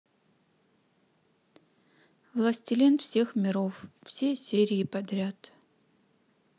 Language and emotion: Russian, neutral